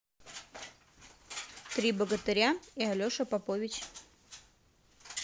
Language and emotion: Russian, neutral